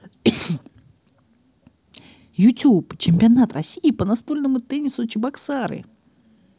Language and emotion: Russian, positive